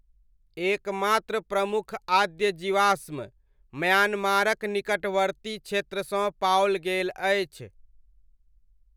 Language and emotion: Maithili, neutral